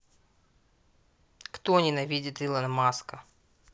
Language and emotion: Russian, angry